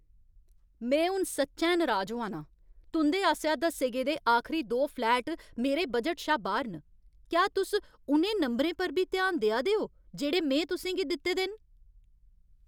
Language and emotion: Dogri, angry